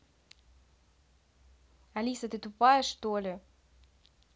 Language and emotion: Russian, angry